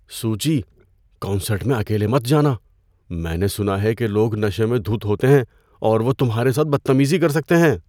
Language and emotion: Urdu, fearful